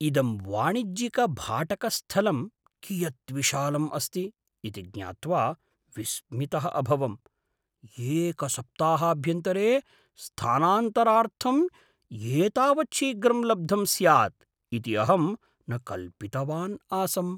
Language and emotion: Sanskrit, surprised